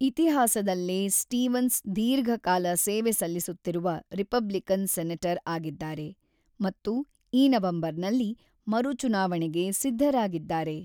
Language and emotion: Kannada, neutral